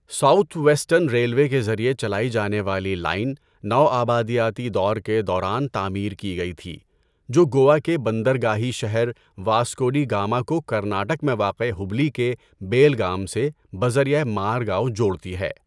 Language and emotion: Urdu, neutral